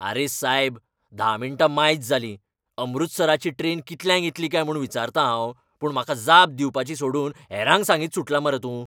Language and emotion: Goan Konkani, angry